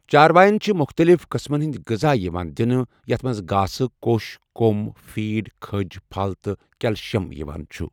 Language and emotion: Kashmiri, neutral